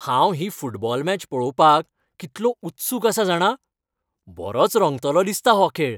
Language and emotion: Goan Konkani, happy